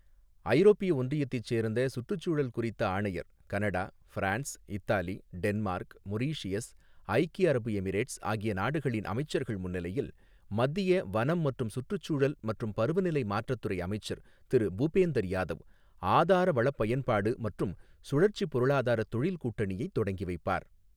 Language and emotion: Tamil, neutral